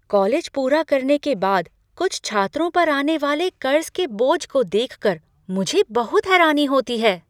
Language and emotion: Hindi, surprised